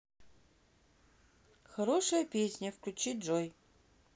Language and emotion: Russian, neutral